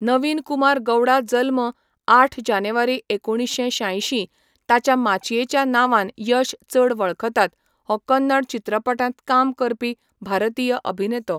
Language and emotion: Goan Konkani, neutral